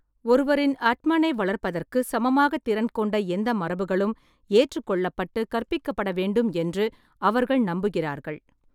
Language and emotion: Tamil, neutral